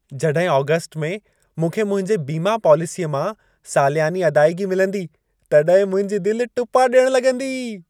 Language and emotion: Sindhi, happy